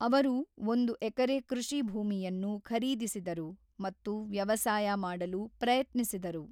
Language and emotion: Kannada, neutral